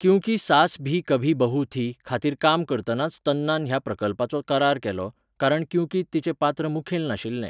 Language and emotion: Goan Konkani, neutral